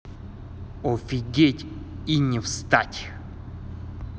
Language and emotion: Russian, angry